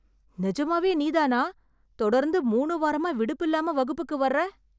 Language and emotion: Tamil, surprised